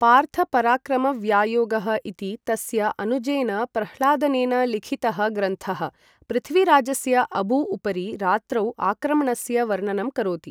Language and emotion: Sanskrit, neutral